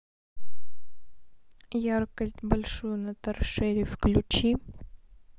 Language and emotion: Russian, neutral